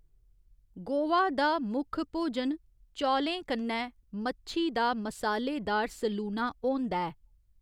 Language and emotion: Dogri, neutral